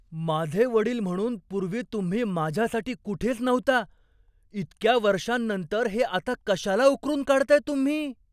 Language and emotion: Marathi, surprised